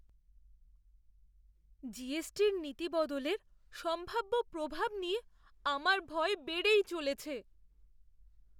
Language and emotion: Bengali, fearful